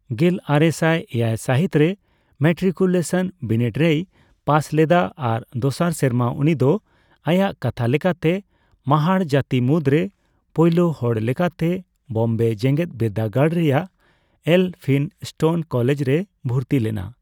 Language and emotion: Santali, neutral